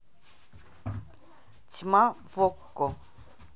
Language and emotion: Russian, neutral